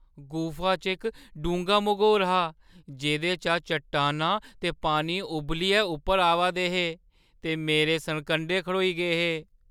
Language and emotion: Dogri, fearful